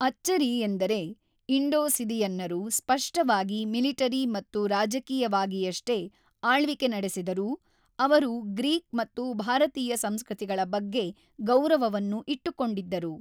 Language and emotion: Kannada, neutral